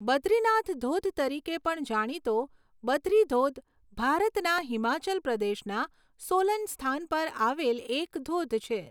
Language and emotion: Gujarati, neutral